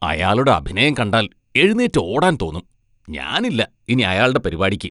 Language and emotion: Malayalam, disgusted